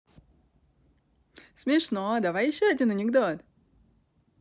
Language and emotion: Russian, positive